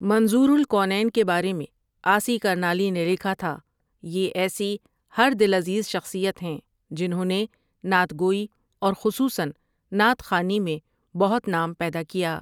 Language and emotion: Urdu, neutral